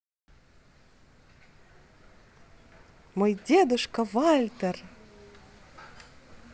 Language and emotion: Russian, positive